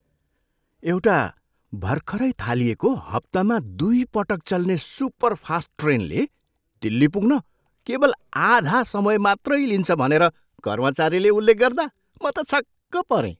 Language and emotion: Nepali, surprised